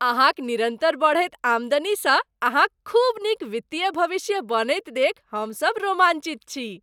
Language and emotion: Maithili, happy